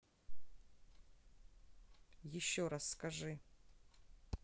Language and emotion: Russian, neutral